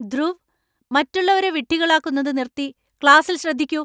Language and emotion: Malayalam, angry